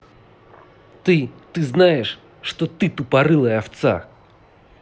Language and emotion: Russian, angry